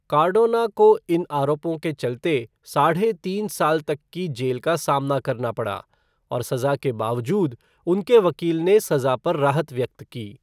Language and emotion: Hindi, neutral